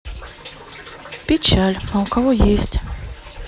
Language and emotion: Russian, sad